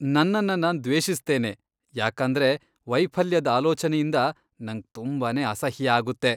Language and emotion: Kannada, disgusted